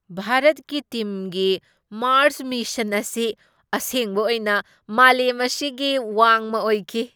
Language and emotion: Manipuri, surprised